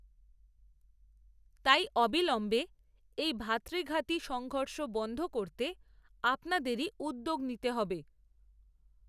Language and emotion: Bengali, neutral